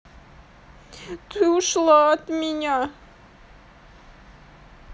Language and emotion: Russian, sad